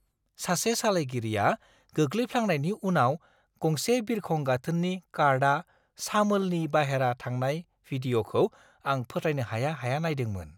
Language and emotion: Bodo, surprised